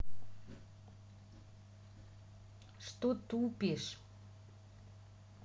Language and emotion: Russian, neutral